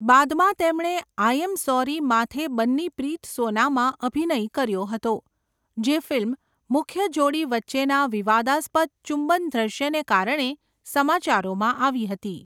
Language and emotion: Gujarati, neutral